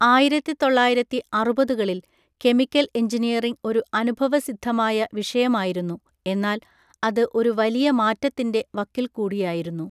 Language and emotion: Malayalam, neutral